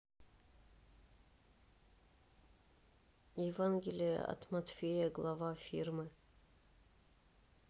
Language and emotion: Russian, neutral